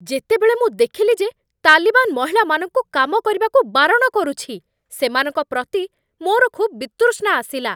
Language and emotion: Odia, angry